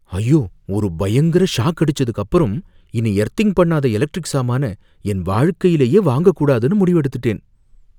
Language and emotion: Tamil, fearful